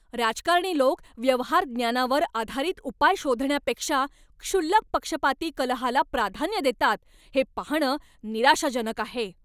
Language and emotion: Marathi, angry